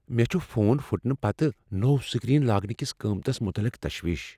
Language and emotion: Kashmiri, fearful